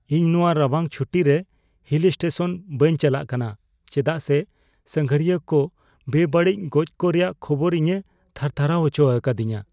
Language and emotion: Santali, fearful